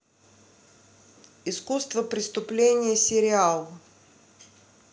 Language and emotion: Russian, neutral